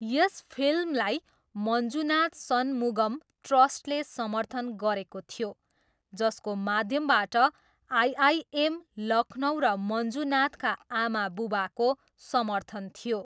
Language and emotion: Nepali, neutral